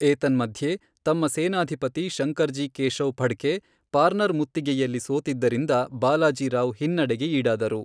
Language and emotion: Kannada, neutral